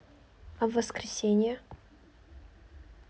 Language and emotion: Russian, neutral